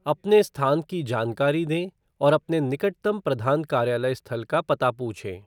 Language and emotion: Hindi, neutral